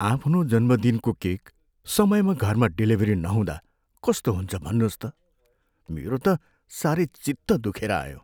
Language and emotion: Nepali, sad